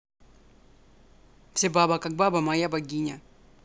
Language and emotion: Russian, neutral